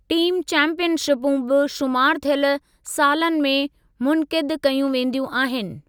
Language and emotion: Sindhi, neutral